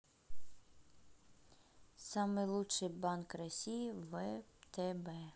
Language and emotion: Russian, neutral